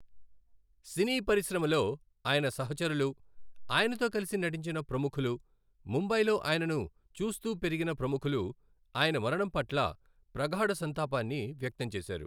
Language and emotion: Telugu, neutral